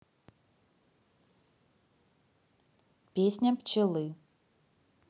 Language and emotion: Russian, neutral